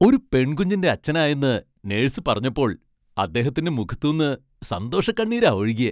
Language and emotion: Malayalam, happy